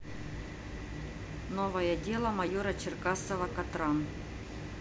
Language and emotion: Russian, neutral